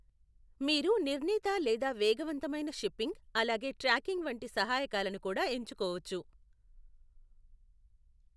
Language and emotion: Telugu, neutral